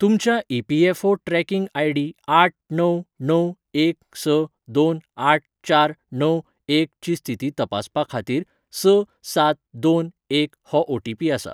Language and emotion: Goan Konkani, neutral